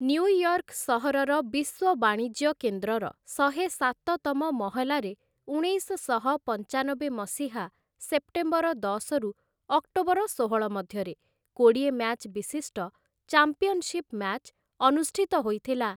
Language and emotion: Odia, neutral